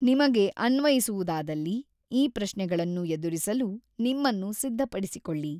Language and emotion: Kannada, neutral